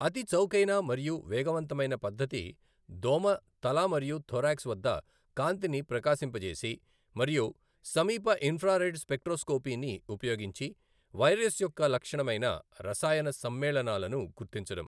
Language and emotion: Telugu, neutral